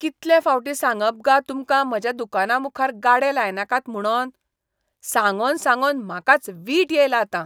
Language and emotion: Goan Konkani, disgusted